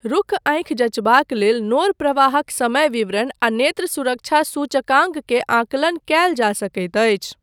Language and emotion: Maithili, neutral